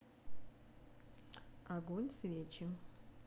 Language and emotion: Russian, neutral